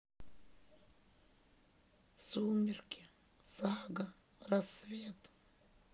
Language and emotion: Russian, sad